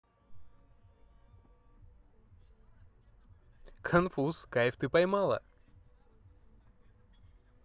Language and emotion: Russian, positive